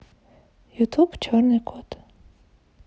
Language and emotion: Russian, neutral